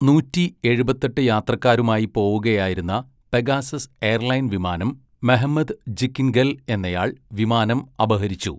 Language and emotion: Malayalam, neutral